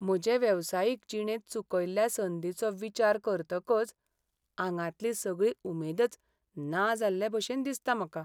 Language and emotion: Goan Konkani, sad